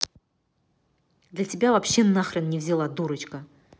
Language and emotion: Russian, angry